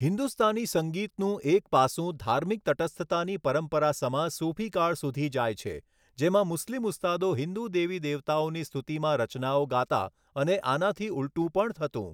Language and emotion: Gujarati, neutral